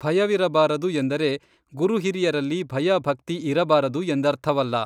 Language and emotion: Kannada, neutral